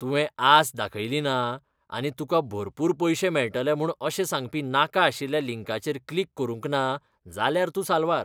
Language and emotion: Goan Konkani, disgusted